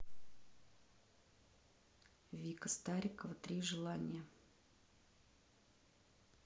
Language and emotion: Russian, neutral